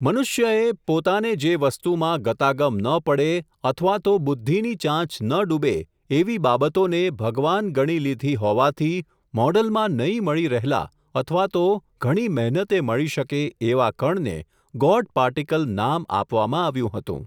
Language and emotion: Gujarati, neutral